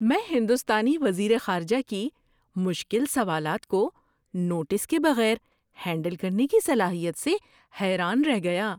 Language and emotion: Urdu, surprised